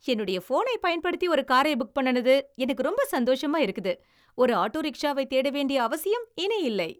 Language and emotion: Tamil, happy